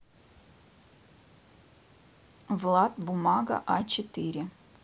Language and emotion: Russian, neutral